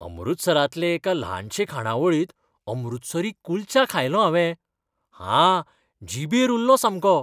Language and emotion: Goan Konkani, happy